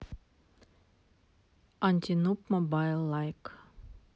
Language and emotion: Russian, neutral